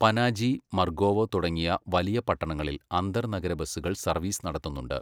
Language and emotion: Malayalam, neutral